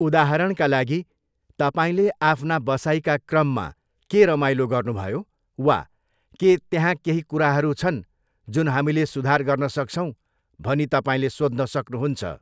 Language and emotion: Nepali, neutral